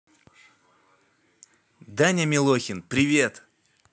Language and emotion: Russian, positive